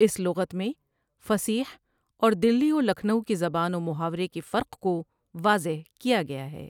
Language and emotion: Urdu, neutral